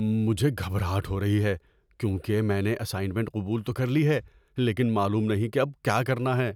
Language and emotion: Urdu, fearful